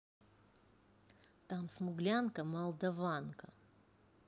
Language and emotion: Russian, neutral